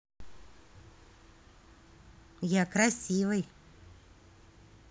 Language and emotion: Russian, positive